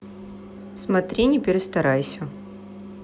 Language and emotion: Russian, neutral